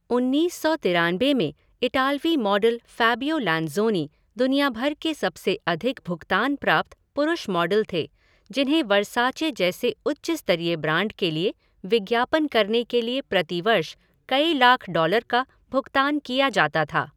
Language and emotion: Hindi, neutral